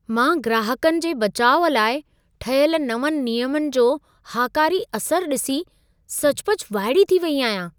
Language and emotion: Sindhi, surprised